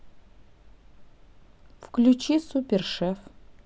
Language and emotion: Russian, neutral